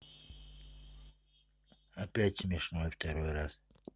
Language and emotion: Russian, neutral